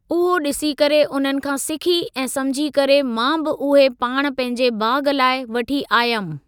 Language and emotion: Sindhi, neutral